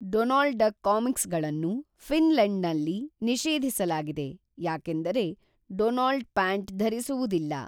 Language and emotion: Kannada, neutral